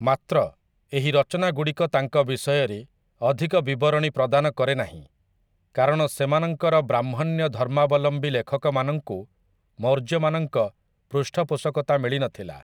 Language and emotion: Odia, neutral